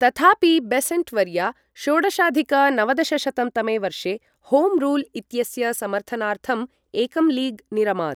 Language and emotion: Sanskrit, neutral